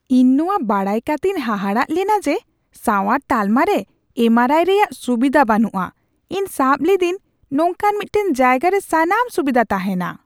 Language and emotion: Santali, surprised